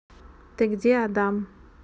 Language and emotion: Russian, neutral